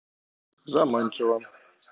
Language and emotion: Russian, neutral